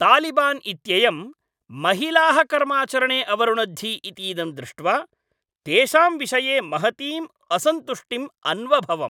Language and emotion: Sanskrit, angry